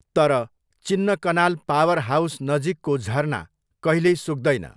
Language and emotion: Nepali, neutral